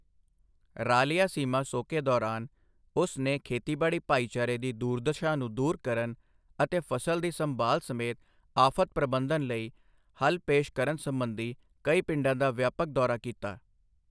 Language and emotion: Punjabi, neutral